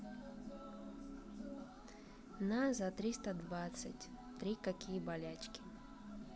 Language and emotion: Russian, neutral